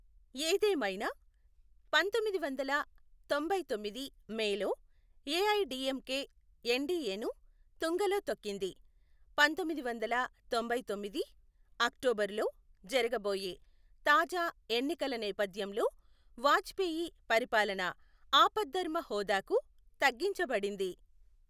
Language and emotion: Telugu, neutral